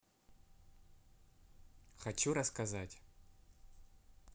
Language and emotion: Russian, neutral